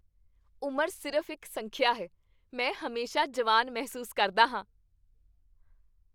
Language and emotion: Punjabi, happy